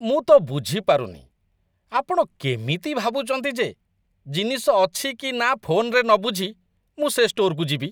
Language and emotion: Odia, disgusted